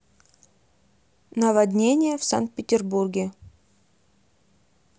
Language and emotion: Russian, neutral